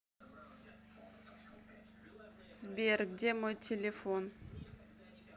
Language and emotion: Russian, neutral